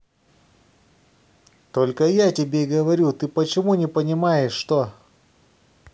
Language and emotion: Russian, angry